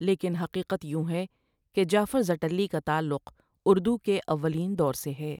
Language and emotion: Urdu, neutral